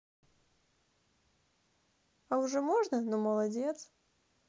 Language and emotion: Russian, positive